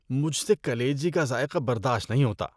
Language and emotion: Urdu, disgusted